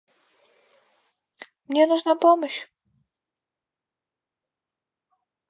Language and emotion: Russian, neutral